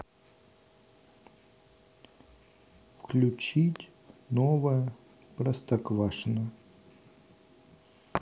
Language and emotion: Russian, neutral